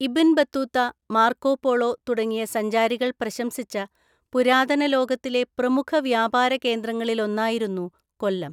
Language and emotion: Malayalam, neutral